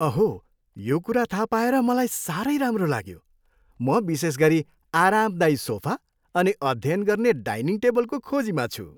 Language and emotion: Nepali, happy